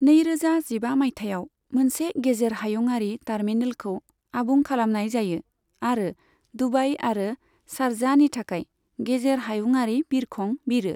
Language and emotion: Bodo, neutral